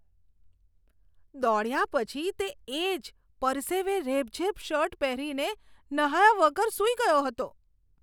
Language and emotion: Gujarati, disgusted